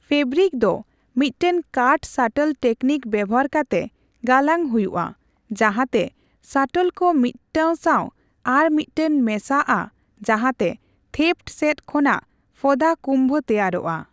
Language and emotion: Santali, neutral